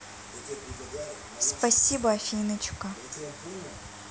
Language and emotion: Russian, neutral